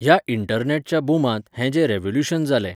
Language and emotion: Goan Konkani, neutral